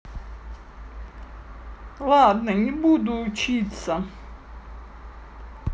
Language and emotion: Russian, neutral